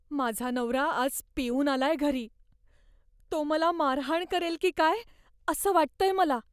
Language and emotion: Marathi, fearful